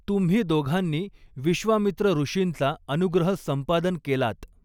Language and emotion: Marathi, neutral